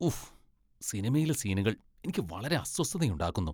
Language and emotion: Malayalam, disgusted